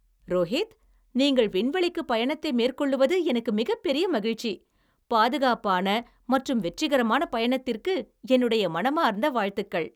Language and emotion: Tamil, happy